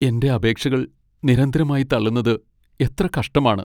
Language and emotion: Malayalam, sad